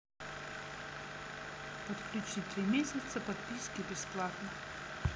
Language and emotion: Russian, neutral